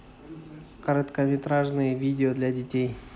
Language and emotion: Russian, neutral